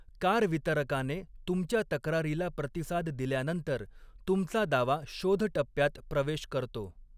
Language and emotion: Marathi, neutral